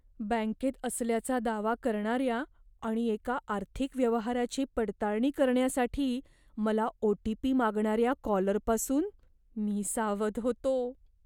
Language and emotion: Marathi, fearful